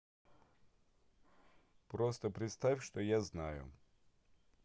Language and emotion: Russian, neutral